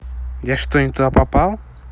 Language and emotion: Russian, neutral